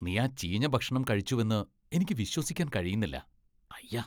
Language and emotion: Malayalam, disgusted